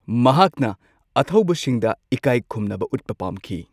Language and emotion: Manipuri, neutral